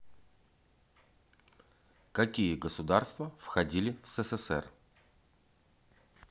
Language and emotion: Russian, neutral